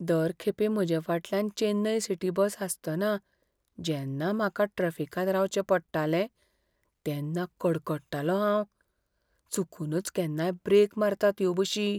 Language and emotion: Goan Konkani, fearful